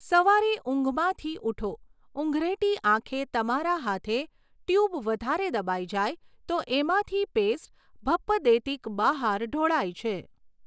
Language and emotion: Gujarati, neutral